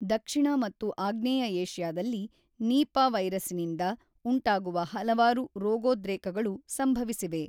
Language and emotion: Kannada, neutral